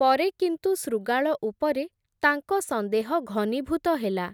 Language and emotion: Odia, neutral